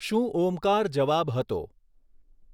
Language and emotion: Gujarati, neutral